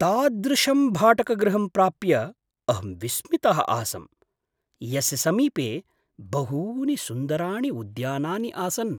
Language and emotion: Sanskrit, surprised